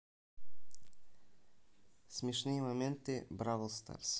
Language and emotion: Russian, neutral